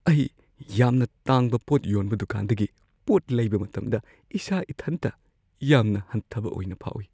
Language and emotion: Manipuri, fearful